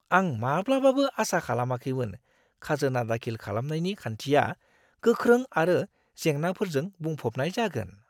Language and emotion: Bodo, surprised